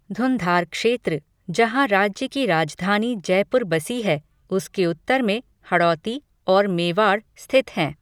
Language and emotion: Hindi, neutral